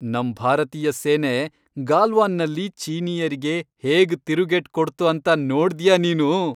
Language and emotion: Kannada, happy